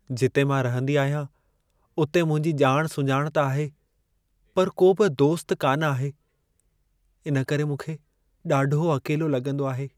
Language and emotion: Sindhi, sad